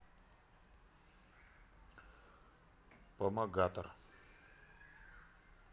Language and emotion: Russian, neutral